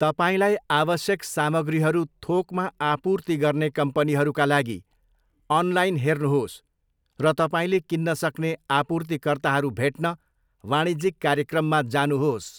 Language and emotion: Nepali, neutral